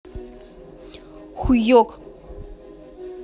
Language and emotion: Russian, angry